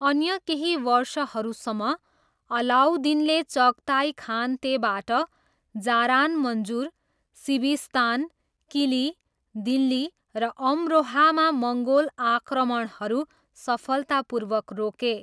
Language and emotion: Nepali, neutral